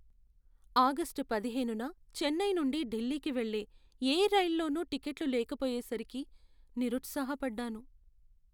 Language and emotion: Telugu, sad